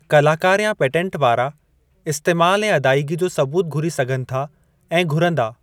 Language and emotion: Sindhi, neutral